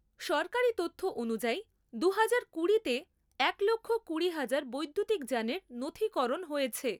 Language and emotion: Bengali, neutral